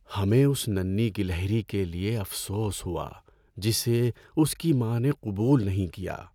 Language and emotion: Urdu, sad